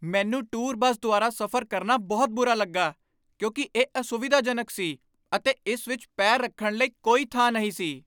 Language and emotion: Punjabi, angry